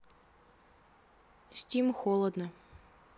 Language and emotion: Russian, neutral